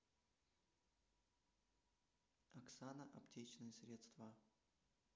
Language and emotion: Russian, neutral